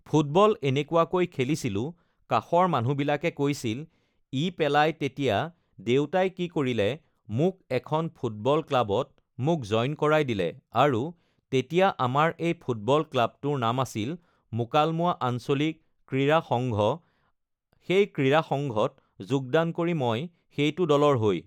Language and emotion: Assamese, neutral